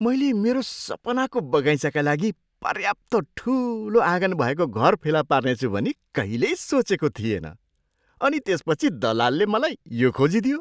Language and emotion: Nepali, surprised